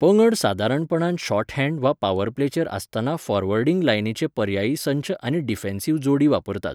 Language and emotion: Goan Konkani, neutral